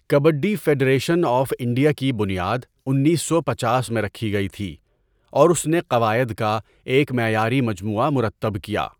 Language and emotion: Urdu, neutral